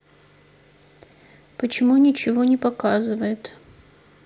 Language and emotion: Russian, sad